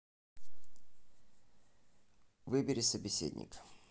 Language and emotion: Russian, neutral